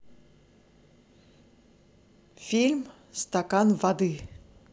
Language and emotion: Russian, positive